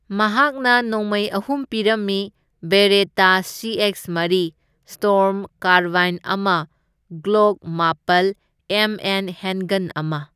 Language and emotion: Manipuri, neutral